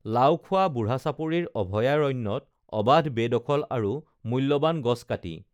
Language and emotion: Assamese, neutral